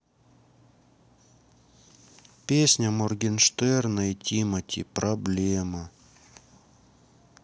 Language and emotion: Russian, sad